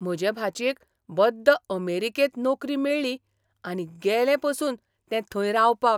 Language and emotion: Goan Konkani, surprised